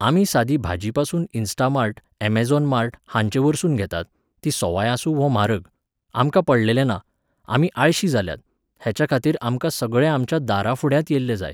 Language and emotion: Goan Konkani, neutral